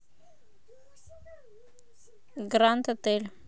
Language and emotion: Russian, neutral